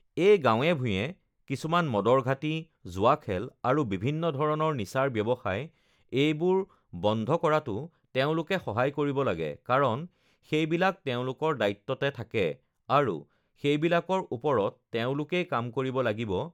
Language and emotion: Assamese, neutral